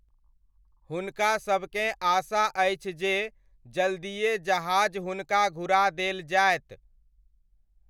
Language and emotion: Maithili, neutral